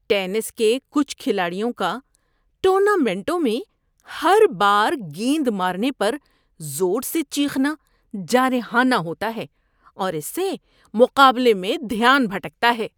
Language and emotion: Urdu, disgusted